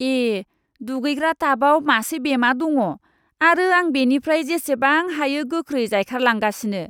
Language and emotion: Bodo, disgusted